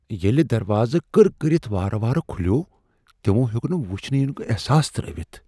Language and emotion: Kashmiri, fearful